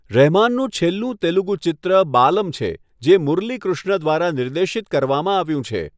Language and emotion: Gujarati, neutral